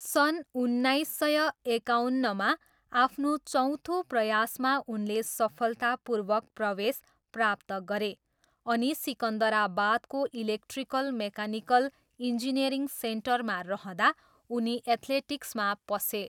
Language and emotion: Nepali, neutral